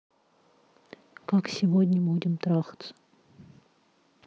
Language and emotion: Russian, neutral